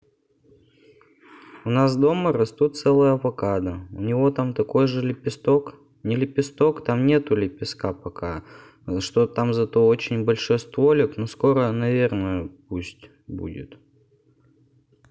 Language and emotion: Russian, neutral